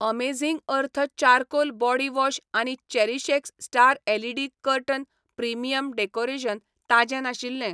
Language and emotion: Goan Konkani, neutral